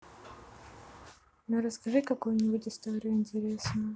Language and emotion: Russian, neutral